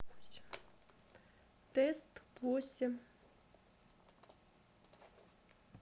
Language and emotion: Russian, neutral